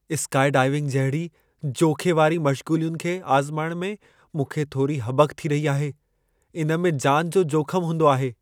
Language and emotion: Sindhi, fearful